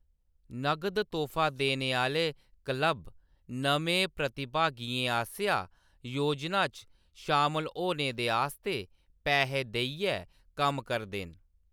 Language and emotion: Dogri, neutral